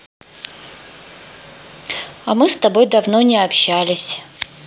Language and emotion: Russian, neutral